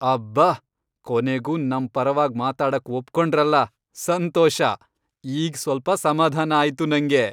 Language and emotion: Kannada, happy